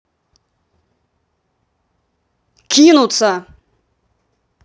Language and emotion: Russian, angry